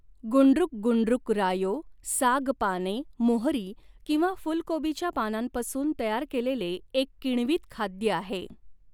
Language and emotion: Marathi, neutral